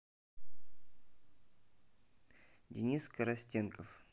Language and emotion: Russian, neutral